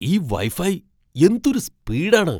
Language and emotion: Malayalam, surprised